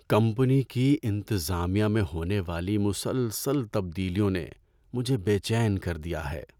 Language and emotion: Urdu, sad